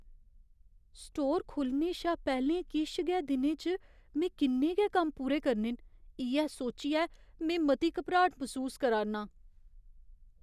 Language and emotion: Dogri, fearful